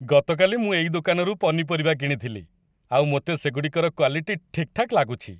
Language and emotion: Odia, happy